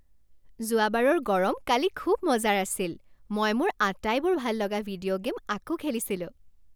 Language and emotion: Assamese, happy